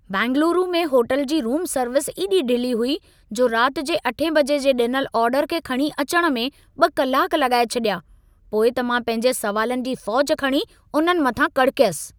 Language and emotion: Sindhi, angry